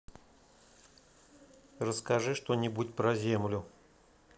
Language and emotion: Russian, neutral